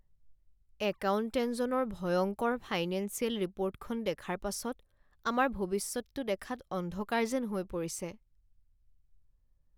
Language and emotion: Assamese, sad